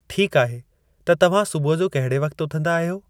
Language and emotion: Sindhi, neutral